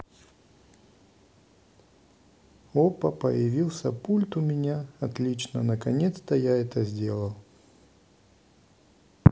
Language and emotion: Russian, neutral